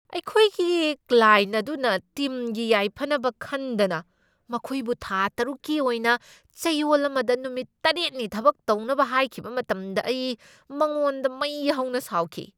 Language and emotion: Manipuri, angry